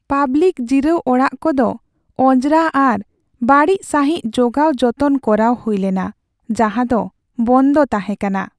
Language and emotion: Santali, sad